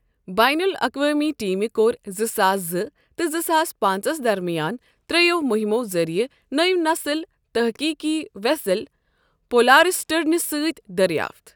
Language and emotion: Kashmiri, neutral